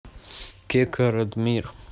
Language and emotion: Russian, neutral